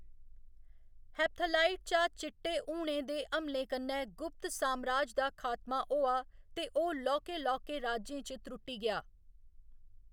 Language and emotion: Dogri, neutral